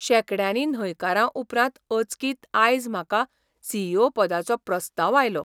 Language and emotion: Goan Konkani, surprised